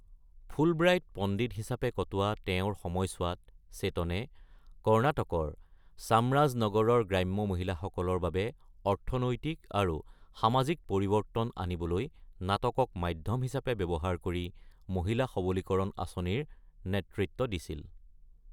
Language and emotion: Assamese, neutral